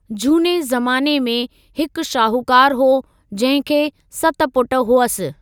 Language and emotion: Sindhi, neutral